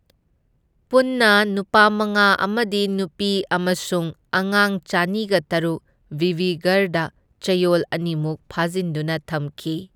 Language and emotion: Manipuri, neutral